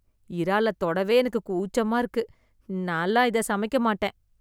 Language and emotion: Tamil, disgusted